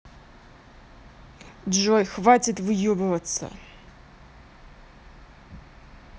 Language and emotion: Russian, angry